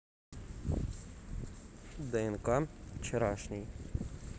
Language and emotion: Russian, neutral